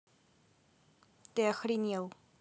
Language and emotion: Russian, angry